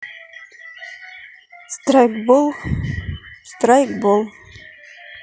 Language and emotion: Russian, neutral